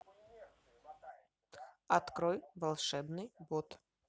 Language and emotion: Russian, neutral